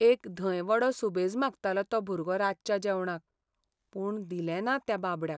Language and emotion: Goan Konkani, sad